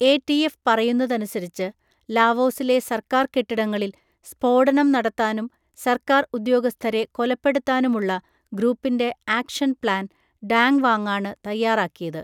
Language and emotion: Malayalam, neutral